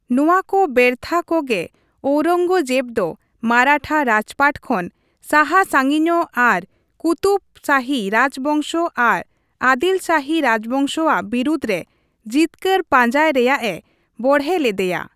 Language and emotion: Santali, neutral